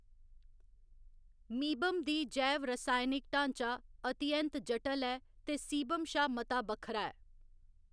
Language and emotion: Dogri, neutral